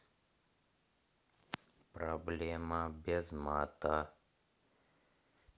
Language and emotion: Russian, neutral